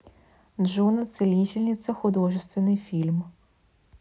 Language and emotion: Russian, neutral